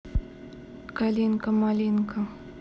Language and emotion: Russian, neutral